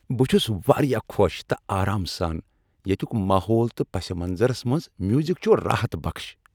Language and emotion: Kashmiri, happy